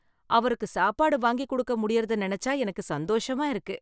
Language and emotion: Tamil, happy